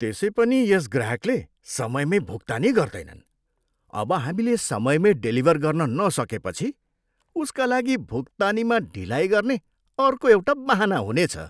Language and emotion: Nepali, disgusted